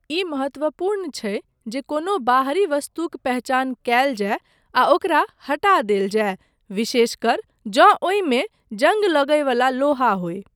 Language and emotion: Maithili, neutral